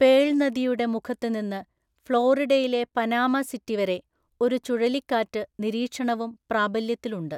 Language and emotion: Malayalam, neutral